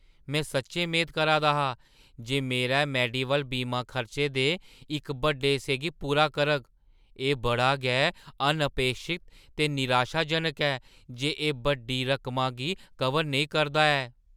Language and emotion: Dogri, surprised